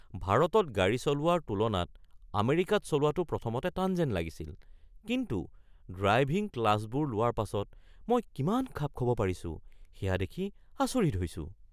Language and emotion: Assamese, surprised